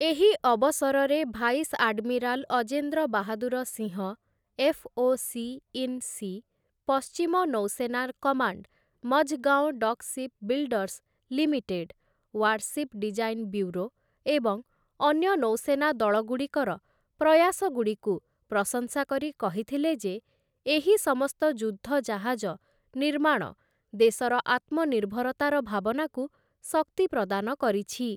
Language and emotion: Odia, neutral